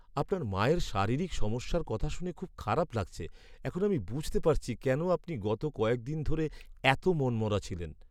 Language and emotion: Bengali, sad